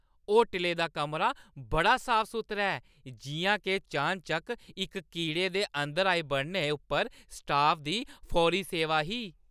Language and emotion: Dogri, happy